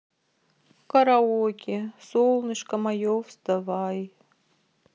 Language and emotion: Russian, sad